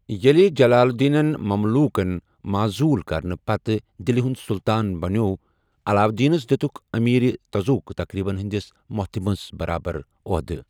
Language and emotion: Kashmiri, neutral